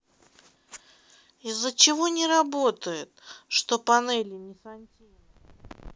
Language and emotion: Russian, sad